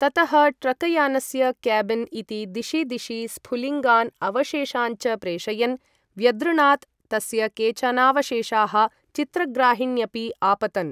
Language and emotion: Sanskrit, neutral